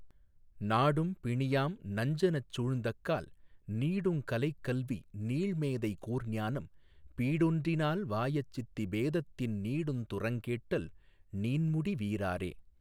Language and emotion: Tamil, neutral